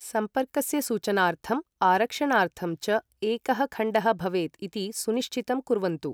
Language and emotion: Sanskrit, neutral